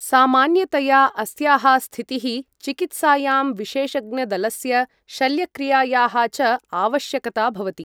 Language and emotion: Sanskrit, neutral